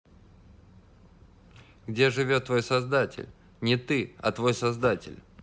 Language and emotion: Russian, neutral